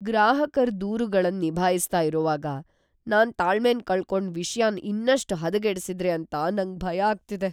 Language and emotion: Kannada, fearful